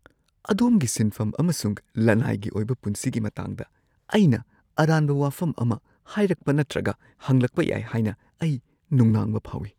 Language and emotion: Manipuri, fearful